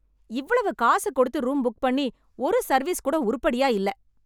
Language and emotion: Tamil, angry